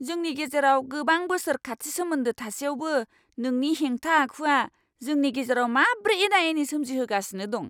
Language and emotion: Bodo, angry